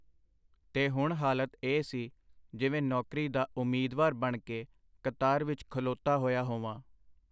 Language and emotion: Punjabi, neutral